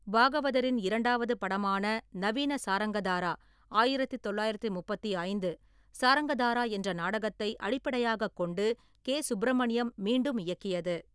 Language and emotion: Tamil, neutral